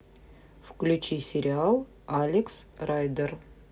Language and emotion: Russian, neutral